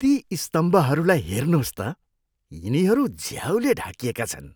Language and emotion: Nepali, disgusted